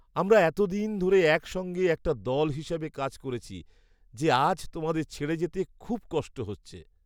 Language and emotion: Bengali, sad